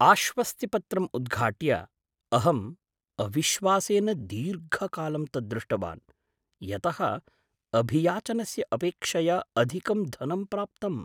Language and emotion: Sanskrit, surprised